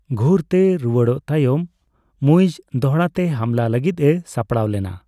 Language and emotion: Santali, neutral